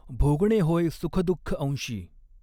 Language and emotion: Marathi, neutral